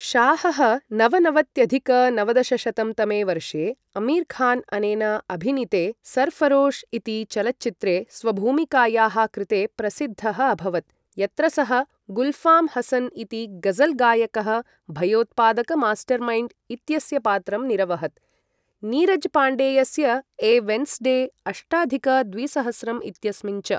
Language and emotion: Sanskrit, neutral